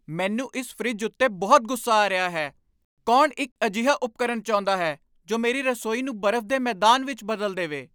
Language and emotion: Punjabi, angry